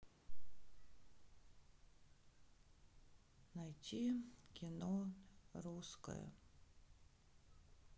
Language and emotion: Russian, sad